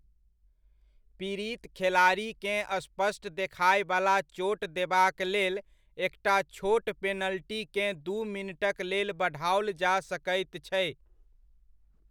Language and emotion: Maithili, neutral